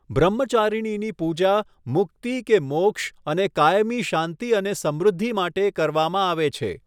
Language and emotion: Gujarati, neutral